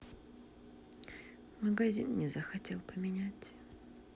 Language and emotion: Russian, sad